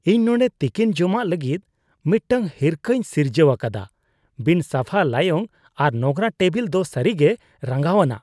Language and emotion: Santali, disgusted